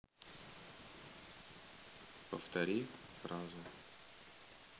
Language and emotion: Russian, neutral